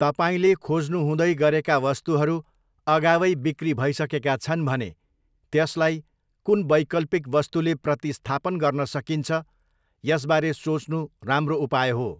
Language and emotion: Nepali, neutral